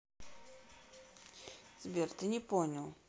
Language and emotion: Russian, neutral